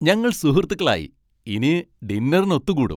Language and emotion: Malayalam, happy